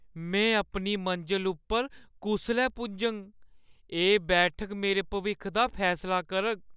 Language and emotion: Dogri, fearful